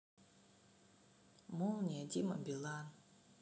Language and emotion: Russian, sad